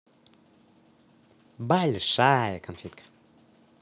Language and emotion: Russian, positive